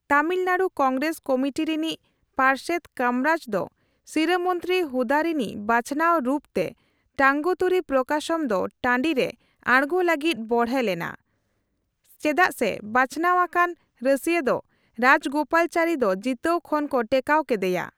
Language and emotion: Santali, neutral